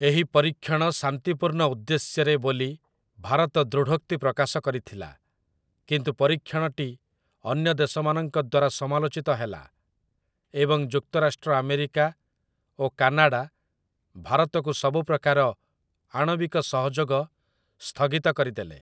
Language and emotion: Odia, neutral